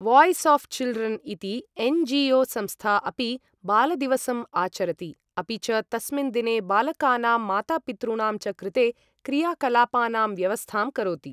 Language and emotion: Sanskrit, neutral